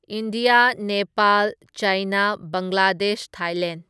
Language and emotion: Manipuri, neutral